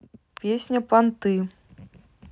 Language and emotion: Russian, neutral